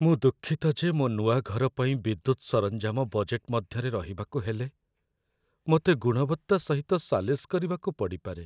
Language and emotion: Odia, sad